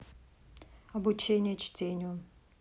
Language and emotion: Russian, neutral